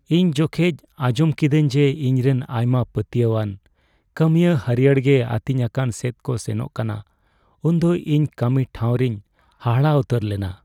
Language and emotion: Santali, sad